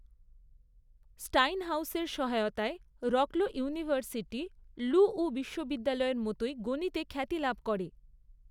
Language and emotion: Bengali, neutral